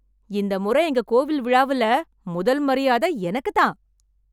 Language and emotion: Tamil, happy